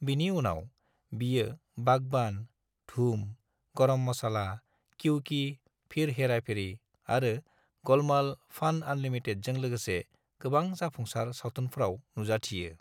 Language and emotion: Bodo, neutral